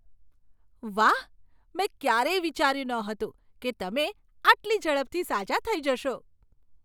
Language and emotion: Gujarati, surprised